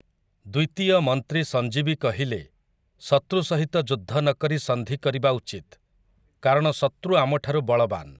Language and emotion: Odia, neutral